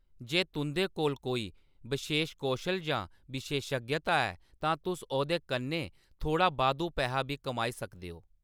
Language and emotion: Dogri, neutral